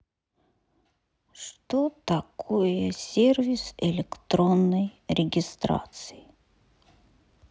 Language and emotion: Russian, sad